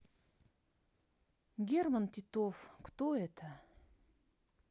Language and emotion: Russian, neutral